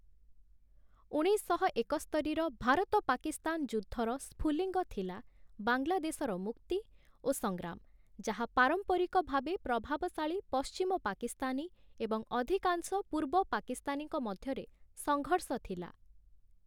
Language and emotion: Odia, neutral